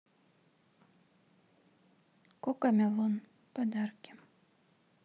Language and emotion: Russian, neutral